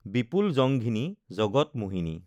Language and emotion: Assamese, neutral